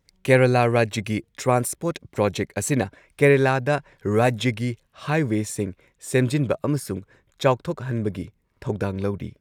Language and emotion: Manipuri, neutral